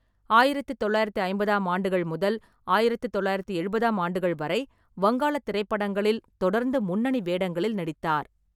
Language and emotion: Tamil, neutral